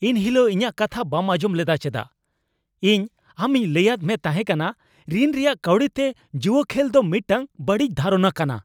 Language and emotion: Santali, angry